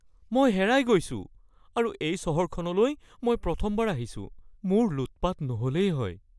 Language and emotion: Assamese, fearful